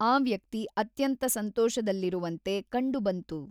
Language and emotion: Kannada, neutral